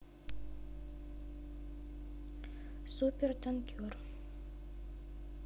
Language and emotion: Russian, neutral